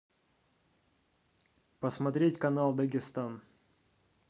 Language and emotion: Russian, neutral